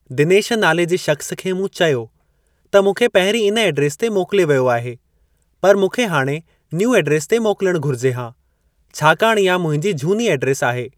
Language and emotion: Sindhi, neutral